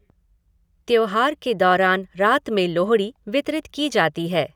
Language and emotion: Hindi, neutral